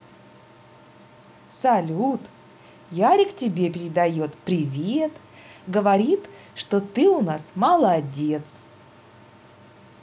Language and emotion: Russian, positive